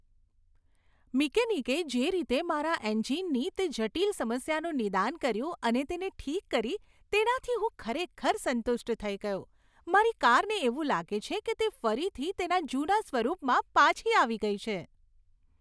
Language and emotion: Gujarati, happy